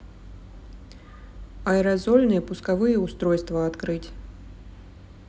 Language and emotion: Russian, neutral